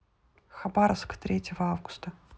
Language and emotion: Russian, neutral